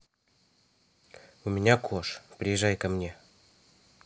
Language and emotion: Russian, neutral